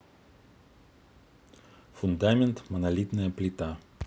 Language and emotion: Russian, neutral